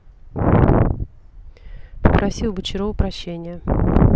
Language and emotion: Russian, neutral